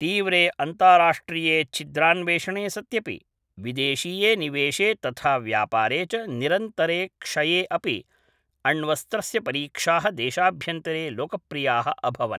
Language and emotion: Sanskrit, neutral